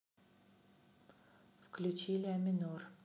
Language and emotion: Russian, neutral